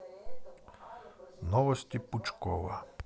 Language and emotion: Russian, neutral